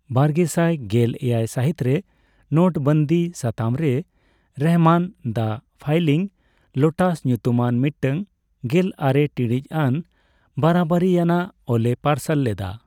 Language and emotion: Santali, neutral